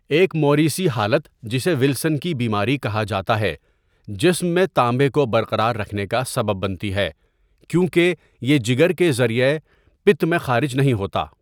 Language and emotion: Urdu, neutral